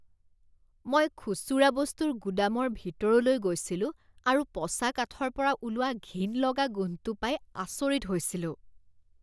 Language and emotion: Assamese, disgusted